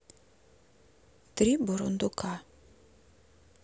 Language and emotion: Russian, neutral